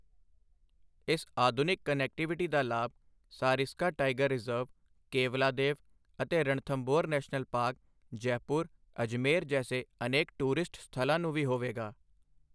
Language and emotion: Punjabi, neutral